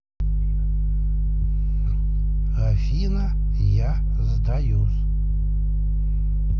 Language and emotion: Russian, neutral